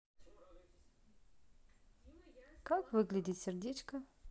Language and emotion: Russian, neutral